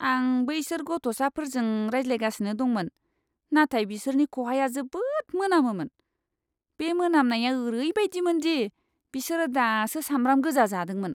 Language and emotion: Bodo, disgusted